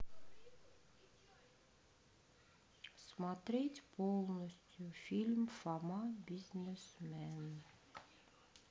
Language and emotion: Russian, sad